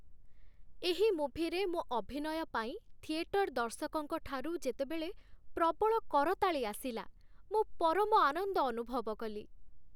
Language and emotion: Odia, happy